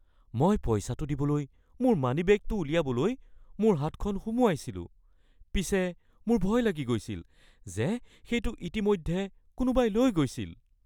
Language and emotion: Assamese, fearful